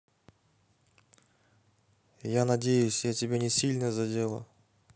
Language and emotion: Russian, sad